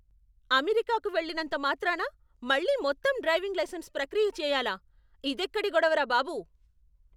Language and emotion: Telugu, angry